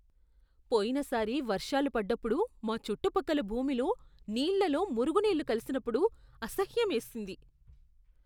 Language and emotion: Telugu, disgusted